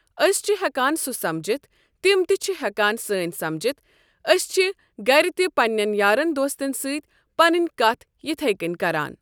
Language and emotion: Kashmiri, neutral